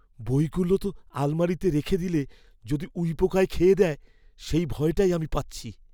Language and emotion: Bengali, fearful